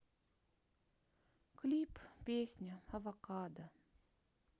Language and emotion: Russian, sad